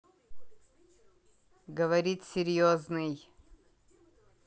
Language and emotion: Russian, neutral